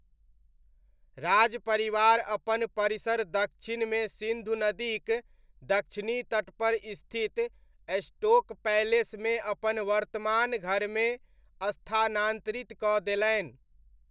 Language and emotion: Maithili, neutral